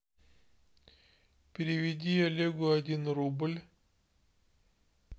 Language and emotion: Russian, neutral